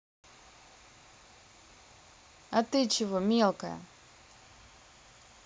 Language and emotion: Russian, neutral